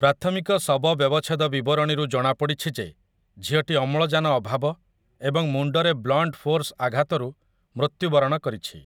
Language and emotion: Odia, neutral